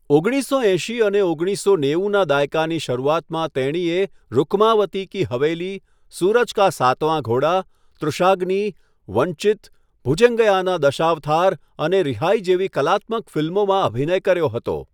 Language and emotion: Gujarati, neutral